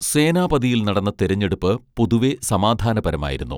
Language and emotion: Malayalam, neutral